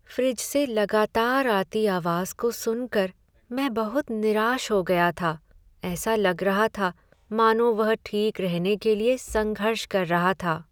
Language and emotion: Hindi, sad